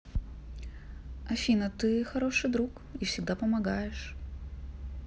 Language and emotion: Russian, neutral